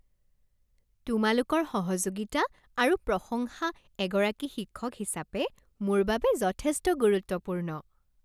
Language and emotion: Assamese, happy